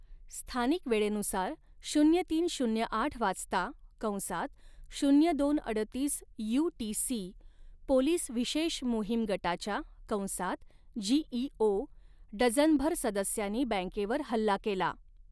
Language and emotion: Marathi, neutral